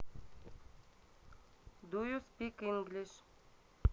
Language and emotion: Russian, neutral